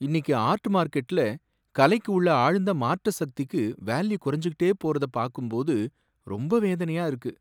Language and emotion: Tamil, sad